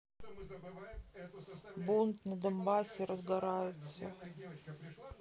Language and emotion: Russian, sad